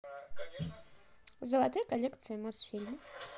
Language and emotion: Russian, neutral